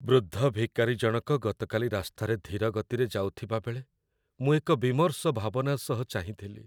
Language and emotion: Odia, sad